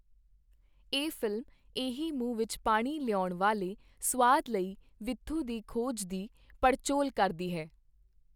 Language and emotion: Punjabi, neutral